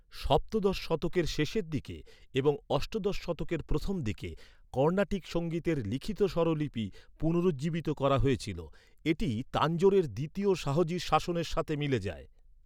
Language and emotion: Bengali, neutral